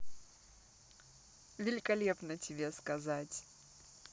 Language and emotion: Russian, positive